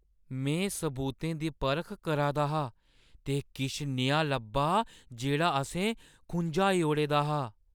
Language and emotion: Dogri, surprised